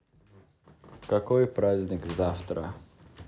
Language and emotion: Russian, neutral